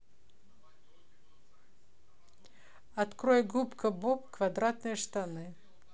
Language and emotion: Russian, neutral